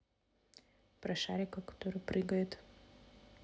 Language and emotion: Russian, neutral